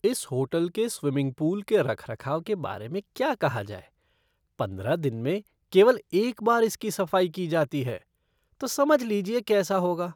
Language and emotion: Hindi, disgusted